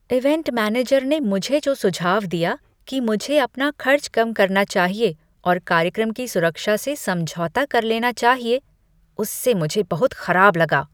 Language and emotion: Hindi, disgusted